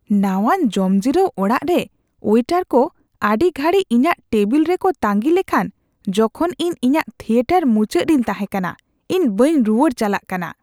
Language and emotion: Santali, disgusted